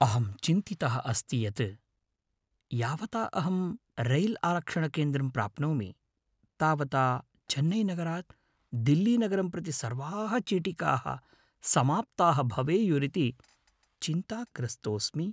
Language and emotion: Sanskrit, fearful